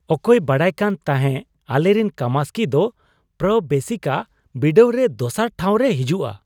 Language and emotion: Santali, surprised